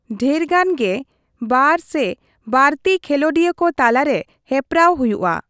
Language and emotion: Santali, neutral